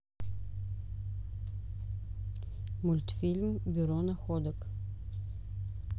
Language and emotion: Russian, neutral